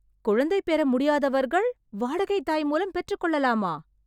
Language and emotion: Tamil, surprised